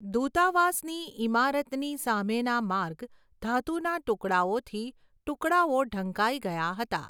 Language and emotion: Gujarati, neutral